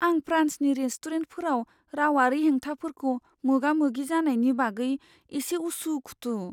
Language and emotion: Bodo, fearful